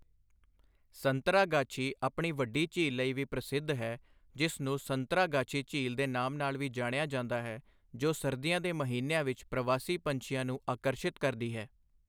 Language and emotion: Punjabi, neutral